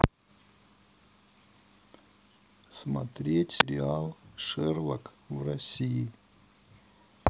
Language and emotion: Russian, neutral